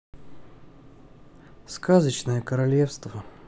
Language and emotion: Russian, sad